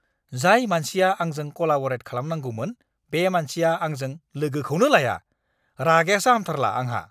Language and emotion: Bodo, angry